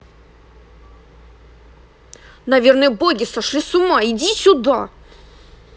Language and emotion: Russian, angry